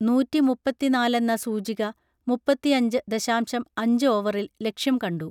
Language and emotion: Malayalam, neutral